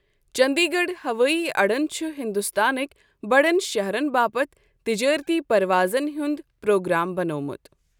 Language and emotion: Kashmiri, neutral